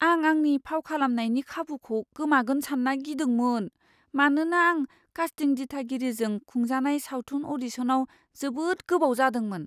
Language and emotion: Bodo, fearful